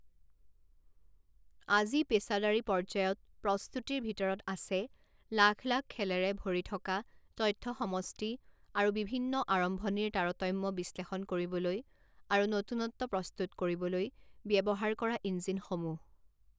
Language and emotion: Assamese, neutral